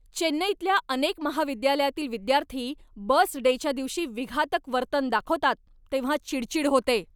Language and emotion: Marathi, angry